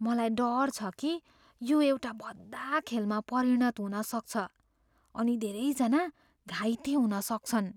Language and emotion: Nepali, fearful